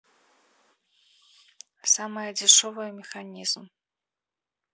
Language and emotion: Russian, neutral